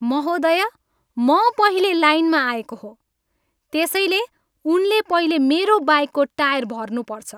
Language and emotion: Nepali, angry